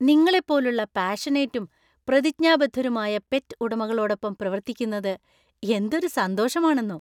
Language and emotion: Malayalam, happy